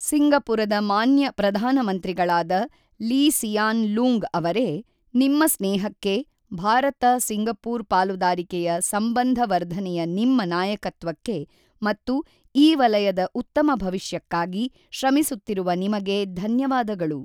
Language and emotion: Kannada, neutral